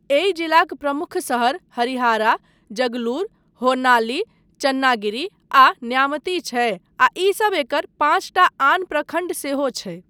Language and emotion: Maithili, neutral